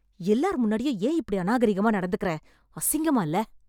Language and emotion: Tamil, angry